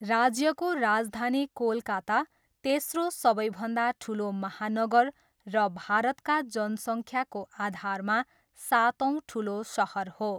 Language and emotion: Nepali, neutral